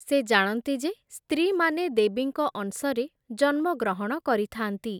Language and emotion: Odia, neutral